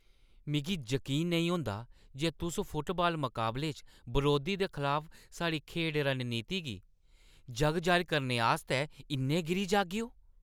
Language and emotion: Dogri, angry